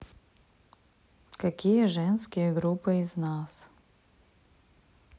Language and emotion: Russian, neutral